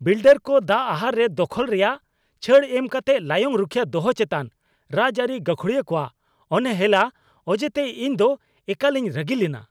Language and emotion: Santali, angry